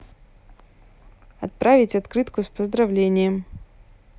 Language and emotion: Russian, neutral